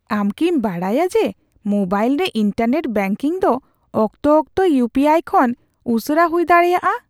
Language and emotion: Santali, surprised